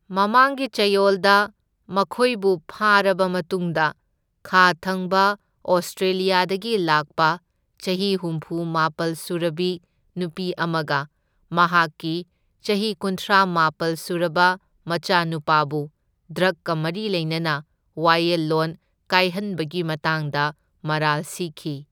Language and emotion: Manipuri, neutral